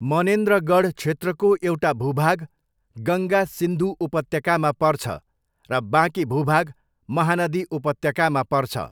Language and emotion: Nepali, neutral